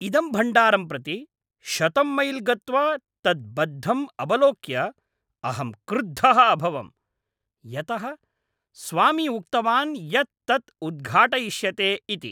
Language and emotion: Sanskrit, angry